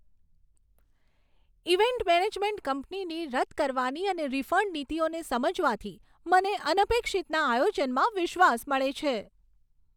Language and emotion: Gujarati, happy